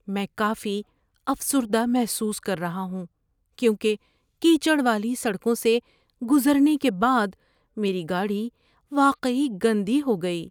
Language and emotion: Urdu, sad